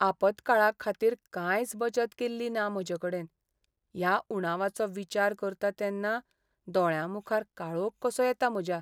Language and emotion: Goan Konkani, sad